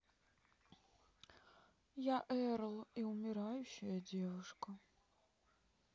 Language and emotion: Russian, sad